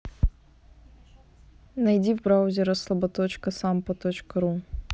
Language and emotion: Russian, neutral